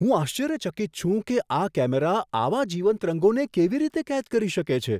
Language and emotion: Gujarati, surprised